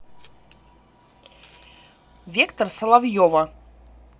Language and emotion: Russian, neutral